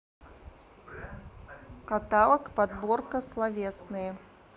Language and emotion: Russian, neutral